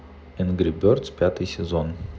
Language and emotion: Russian, neutral